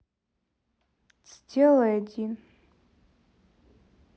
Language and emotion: Russian, sad